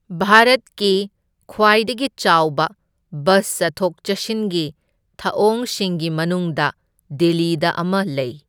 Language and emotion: Manipuri, neutral